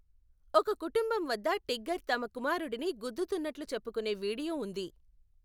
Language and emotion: Telugu, neutral